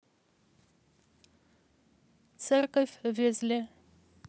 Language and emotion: Russian, neutral